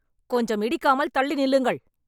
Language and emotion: Tamil, angry